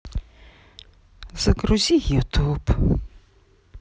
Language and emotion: Russian, sad